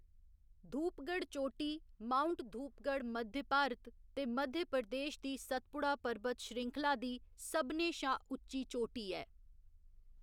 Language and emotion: Dogri, neutral